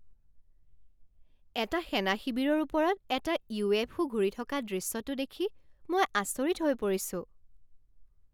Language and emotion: Assamese, surprised